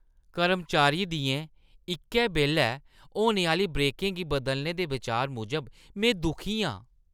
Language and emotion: Dogri, disgusted